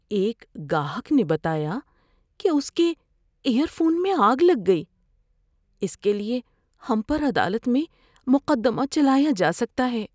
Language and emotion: Urdu, fearful